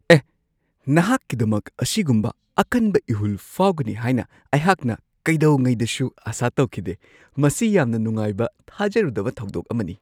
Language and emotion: Manipuri, surprised